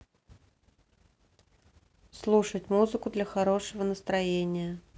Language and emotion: Russian, neutral